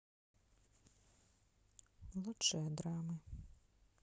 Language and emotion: Russian, sad